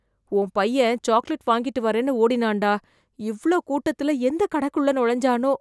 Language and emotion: Tamil, fearful